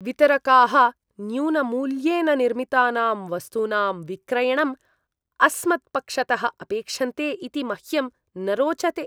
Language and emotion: Sanskrit, disgusted